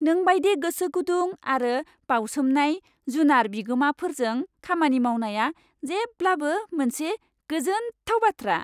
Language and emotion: Bodo, happy